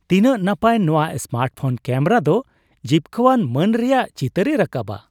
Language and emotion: Santali, surprised